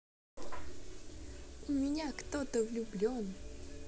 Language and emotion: Russian, positive